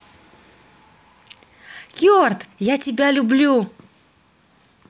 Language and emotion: Russian, positive